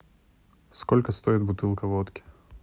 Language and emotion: Russian, neutral